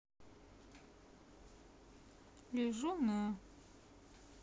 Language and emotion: Russian, neutral